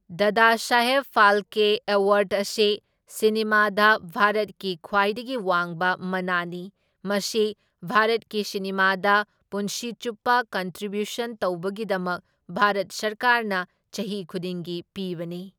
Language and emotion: Manipuri, neutral